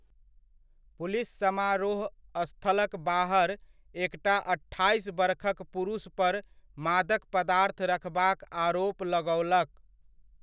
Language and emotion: Maithili, neutral